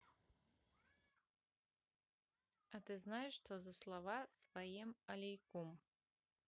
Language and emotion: Russian, neutral